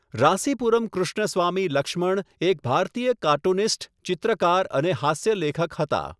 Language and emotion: Gujarati, neutral